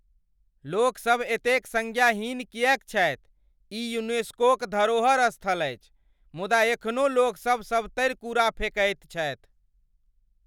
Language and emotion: Maithili, angry